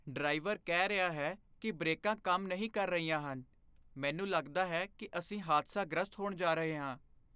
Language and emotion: Punjabi, fearful